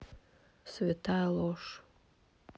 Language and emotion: Russian, neutral